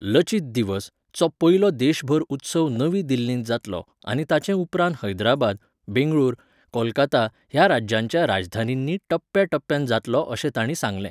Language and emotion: Goan Konkani, neutral